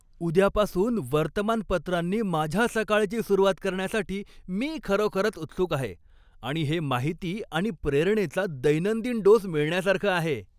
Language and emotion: Marathi, happy